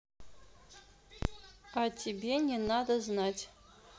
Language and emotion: Russian, neutral